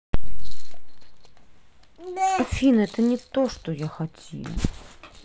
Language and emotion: Russian, sad